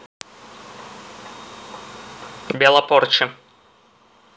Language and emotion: Russian, neutral